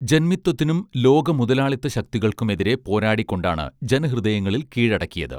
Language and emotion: Malayalam, neutral